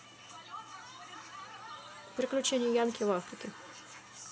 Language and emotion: Russian, neutral